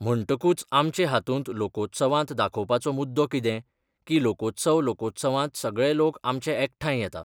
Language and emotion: Goan Konkani, neutral